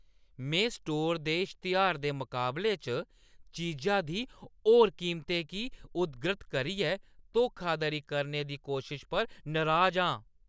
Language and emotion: Dogri, angry